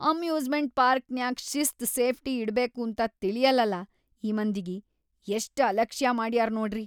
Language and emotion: Kannada, disgusted